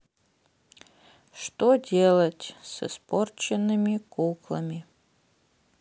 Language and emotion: Russian, sad